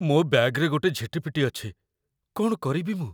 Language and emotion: Odia, fearful